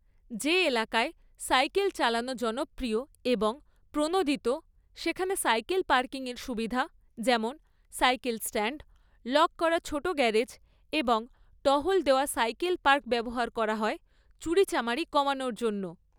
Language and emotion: Bengali, neutral